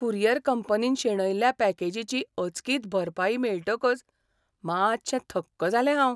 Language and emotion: Goan Konkani, surprised